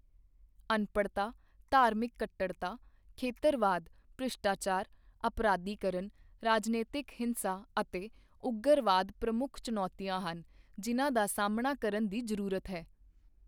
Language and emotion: Punjabi, neutral